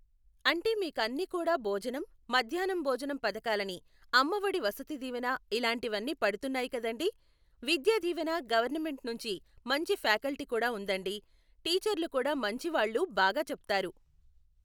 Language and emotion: Telugu, neutral